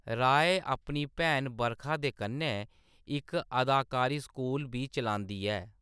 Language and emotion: Dogri, neutral